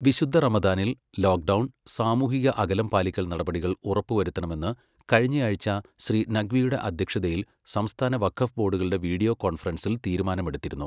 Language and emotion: Malayalam, neutral